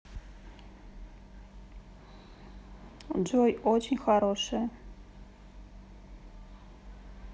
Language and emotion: Russian, neutral